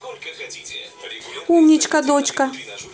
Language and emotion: Russian, positive